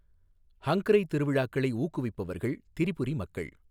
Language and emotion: Tamil, neutral